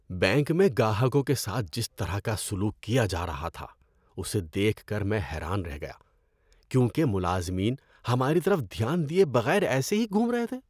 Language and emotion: Urdu, disgusted